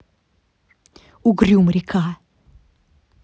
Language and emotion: Russian, angry